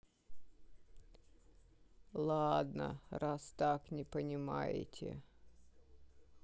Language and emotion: Russian, sad